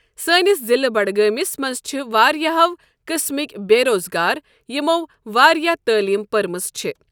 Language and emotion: Kashmiri, neutral